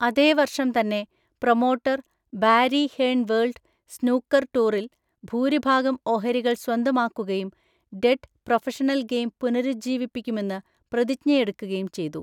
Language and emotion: Malayalam, neutral